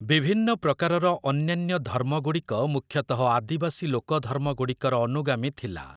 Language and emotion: Odia, neutral